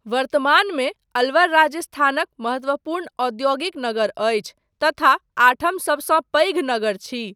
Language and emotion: Maithili, neutral